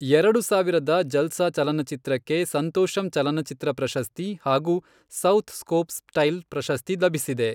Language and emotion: Kannada, neutral